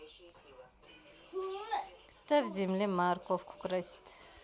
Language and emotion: Russian, neutral